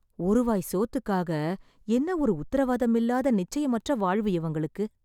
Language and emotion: Tamil, sad